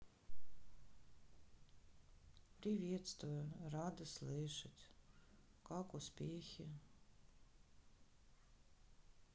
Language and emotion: Russian, sad